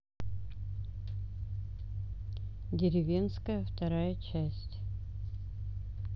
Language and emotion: Russian, neutral